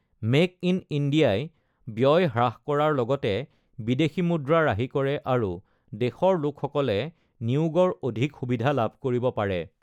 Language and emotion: Assamese, neutral